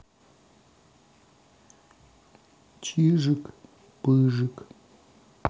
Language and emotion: Russian, sad